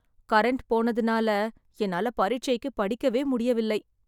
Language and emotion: Tamil, sad